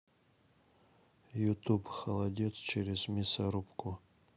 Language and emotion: Russian, neutral